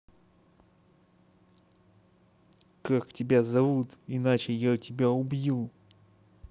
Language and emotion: Russian, angry